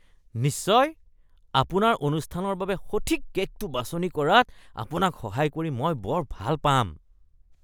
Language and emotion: Assamese, disgusted